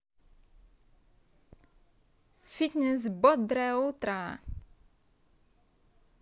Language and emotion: Russian, positive